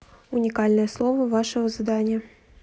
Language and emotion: Russian, neutral